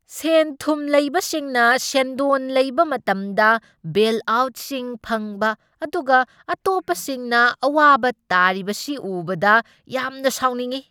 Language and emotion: Manipuri, angry